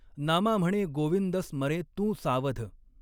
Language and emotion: Marathi, neutral